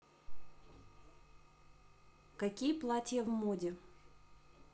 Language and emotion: Russian, neutral